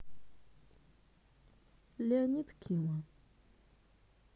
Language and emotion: Russian, neutral